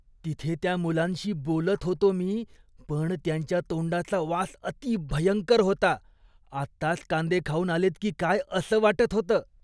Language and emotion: Marathi, disgusted